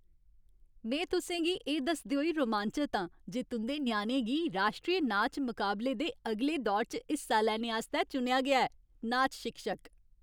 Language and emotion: Dogri, happy